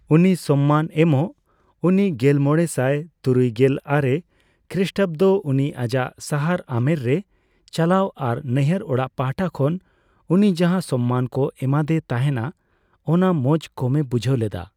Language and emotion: Santali, neutral